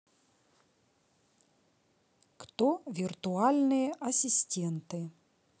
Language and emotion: Russian, neutral